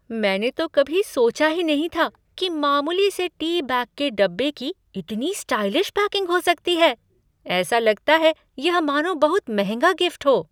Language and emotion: Hindi, surprised